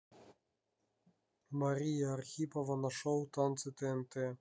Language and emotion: Russian, neutral